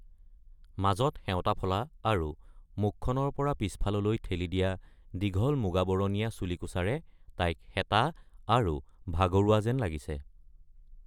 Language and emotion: Assamese, neutral